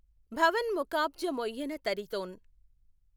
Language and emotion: Telugu, neutral